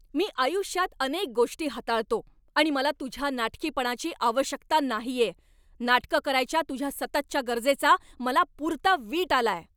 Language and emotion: Marathi, angry